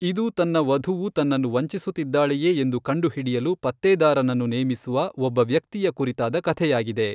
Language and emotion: Kannada, neutral